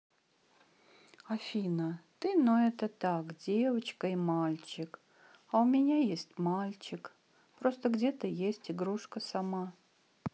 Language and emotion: Russian, sad